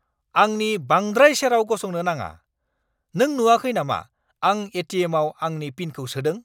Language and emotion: Bodo, angry